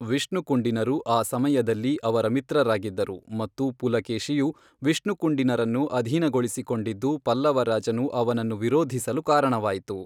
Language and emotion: Kannada, neutral